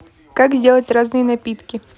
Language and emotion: Russian, neutral